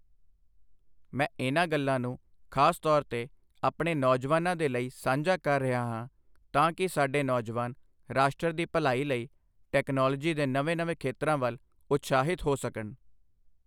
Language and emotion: Punjabi, neutral